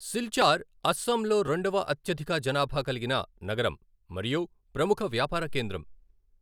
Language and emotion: Telugu, neutral